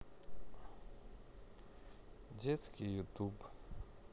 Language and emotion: Russian, sad